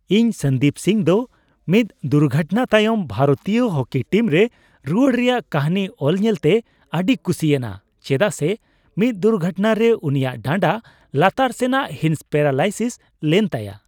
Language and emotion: Santali, happy